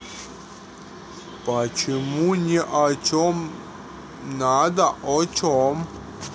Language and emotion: Russian, neutral